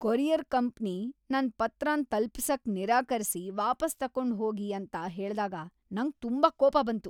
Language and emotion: Kannada, angry